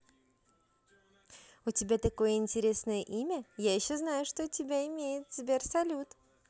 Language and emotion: Russian, positive